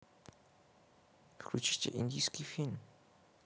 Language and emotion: Russian, neutral